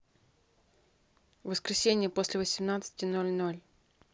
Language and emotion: Russian, neutral